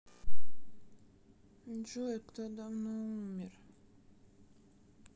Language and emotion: Russian, sad